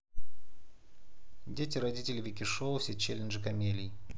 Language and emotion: Russian, neutral